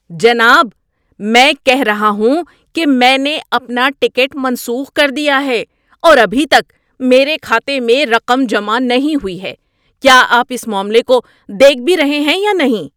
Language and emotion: Urdu, angry